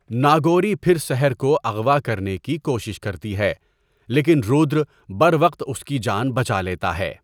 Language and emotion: Urdu, neutral